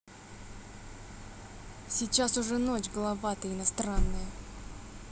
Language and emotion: Russian, angry